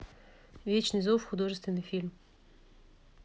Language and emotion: Russian, neutral